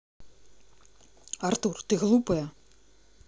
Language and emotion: Russian, angry